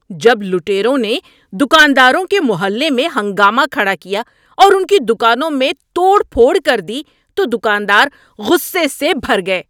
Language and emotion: Urdu, angry